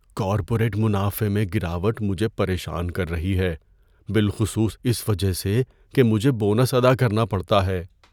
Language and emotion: Urdu, fearful